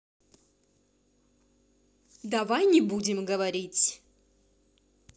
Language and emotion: Russian, angry